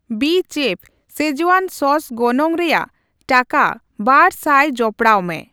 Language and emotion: Santali, neutral